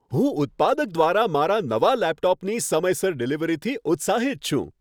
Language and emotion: Gujarati, happy